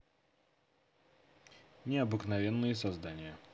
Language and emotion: Russian, neutral